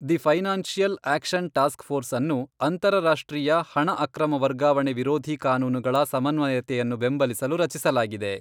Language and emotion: Kannada, neutral